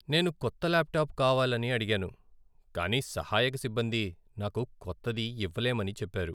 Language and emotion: Telugu, sad